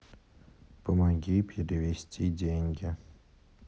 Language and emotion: Russian, neutral